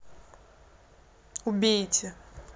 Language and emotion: Russian, neutral